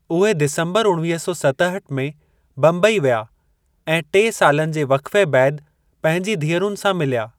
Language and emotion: Sindhi, neutral